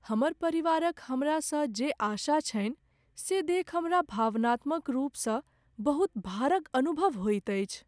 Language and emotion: Maithili, sad